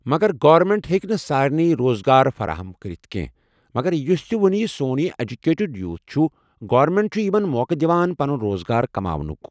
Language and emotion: Kashmiri, neutral